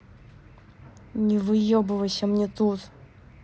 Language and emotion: Russian, angry